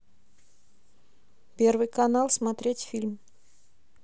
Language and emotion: Russian, neutral